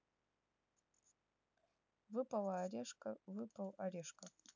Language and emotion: Russian, neutral